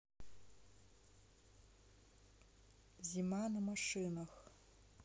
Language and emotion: Russian, neutral